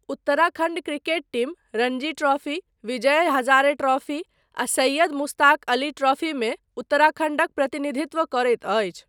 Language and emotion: Maithili, neutral